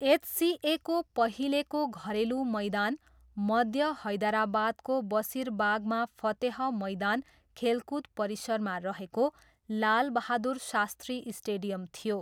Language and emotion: Nepali, neutral